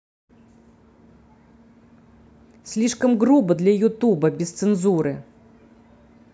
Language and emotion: Russian, angry